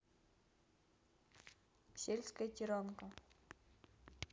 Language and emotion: Russian, neutral